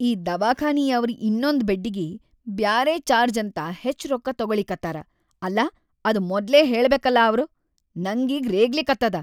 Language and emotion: Kannada, angry